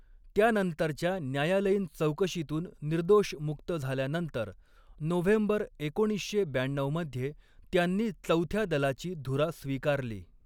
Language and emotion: Marathi, neutral